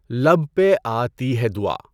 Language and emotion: Urdu, neutral